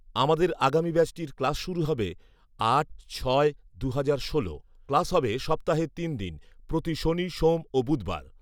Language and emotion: Bengali, neutral